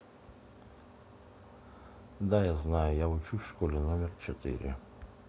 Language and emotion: Russian, neutral